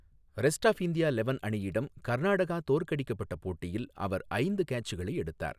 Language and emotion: Tamil, neutral